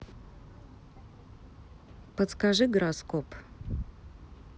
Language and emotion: Russian, neutral